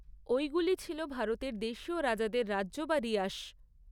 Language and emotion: Bengali, neutral